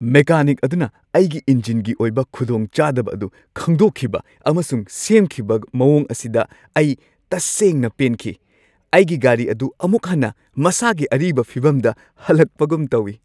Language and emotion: Manipuri, happy